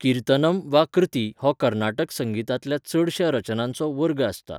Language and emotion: Goan Konkani, neutral